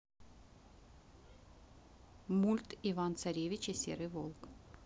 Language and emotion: Russian, neutral